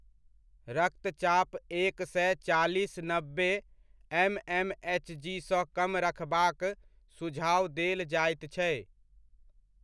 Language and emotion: Maithili, neutral